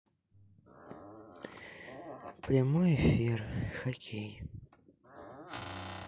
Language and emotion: Russian, sad